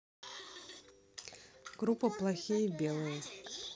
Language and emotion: Russian, neutral